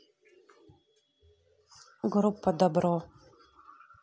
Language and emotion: Russian, neutral